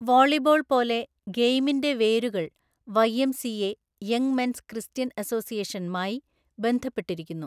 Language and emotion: Malayalam, neutral